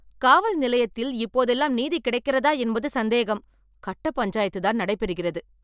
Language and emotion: Tamil, angry